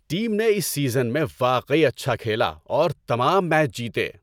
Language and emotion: Urdu, happy